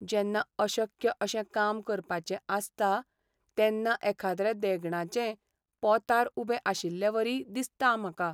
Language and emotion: Goan Konkani, sad